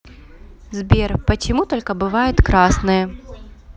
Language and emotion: Russian, neutral